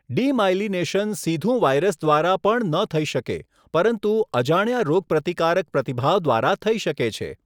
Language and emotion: Gujarati, neutral